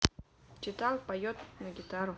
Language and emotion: Russian, neutral